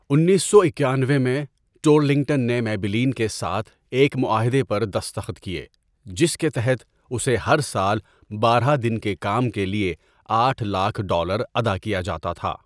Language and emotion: Urdu, neutral